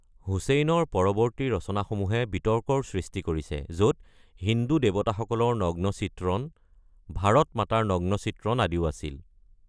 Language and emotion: Assamese, neutral